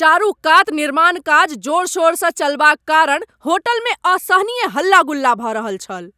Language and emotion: Maithili, angry